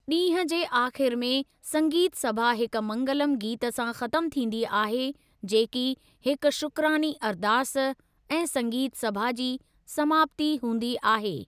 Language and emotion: Sindhi, neutral